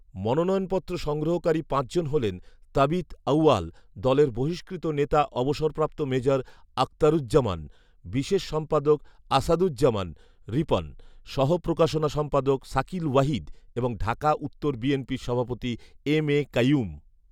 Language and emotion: Bengali, neutral